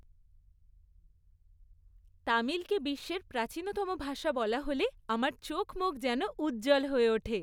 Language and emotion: Bengali, happy